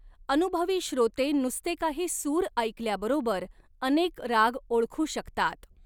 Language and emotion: Marathi, neutral